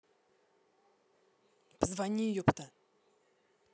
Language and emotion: Russian, angry